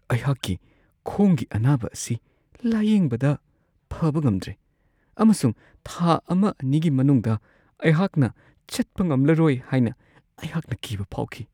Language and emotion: Manipuri, fearful